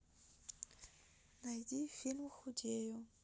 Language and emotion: Russian, neutral